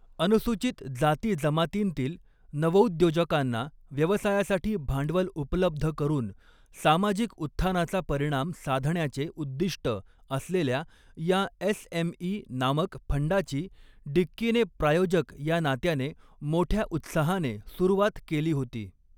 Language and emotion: Marathi, neutral